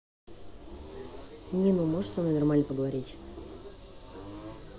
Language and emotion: Russian, neutral